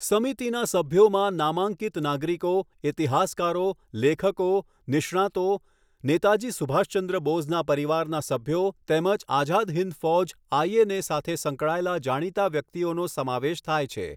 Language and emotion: Gujarati, neutral